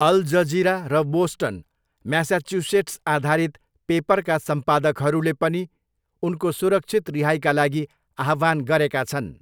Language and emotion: Nepali, neutral